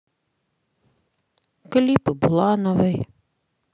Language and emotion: Russian, sad